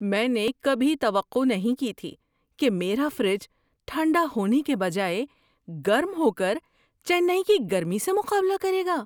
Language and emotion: Urdu, surprised